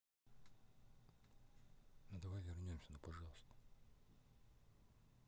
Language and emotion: Russian, neutral